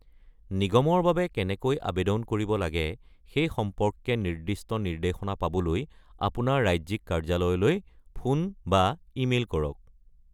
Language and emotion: Assamese, neutral